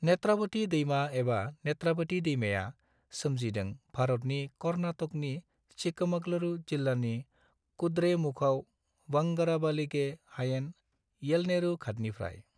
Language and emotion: Bodo, neutral